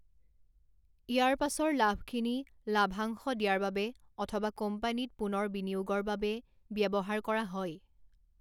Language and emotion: Assamese, neutral